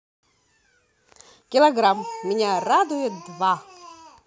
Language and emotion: Russian, positive